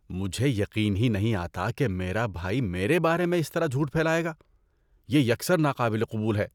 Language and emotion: Urdu, disgusted